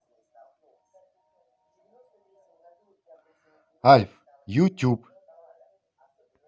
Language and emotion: Russian, positive